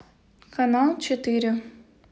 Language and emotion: Russian, neutral